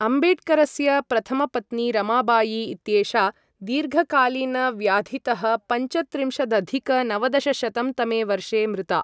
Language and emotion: Sanskrit, neutral